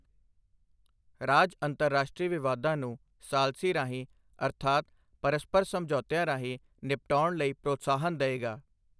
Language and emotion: Punjabi, neutral